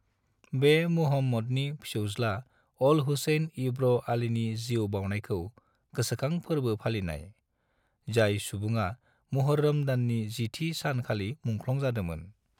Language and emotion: Bodo, neutral